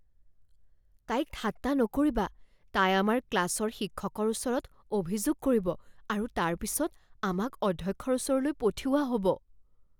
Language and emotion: Assamese, fearful